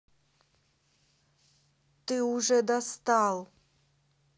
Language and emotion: Russian, angry